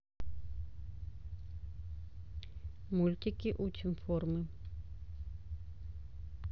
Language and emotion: Russian, neutral